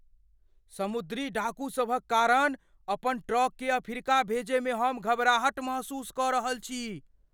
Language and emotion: Maithili, fearful